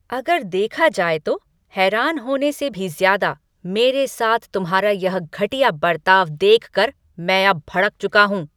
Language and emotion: Hindi, angry